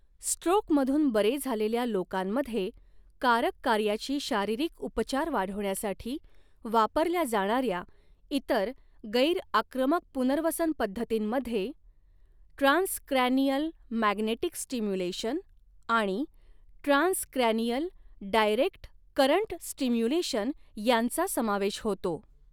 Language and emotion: Marathi, neutral